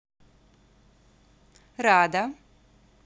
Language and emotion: Russian, positive